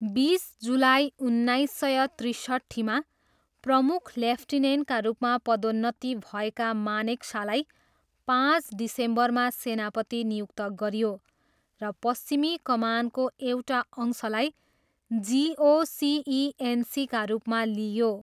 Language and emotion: Nepali, neutral